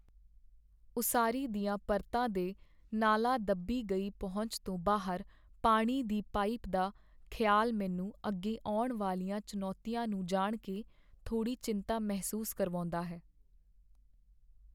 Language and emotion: Punjabi, sad